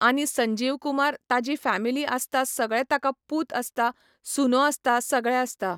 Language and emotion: Goan Konkani, neutral